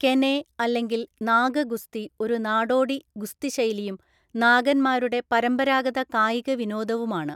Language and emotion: Malayalam, neutral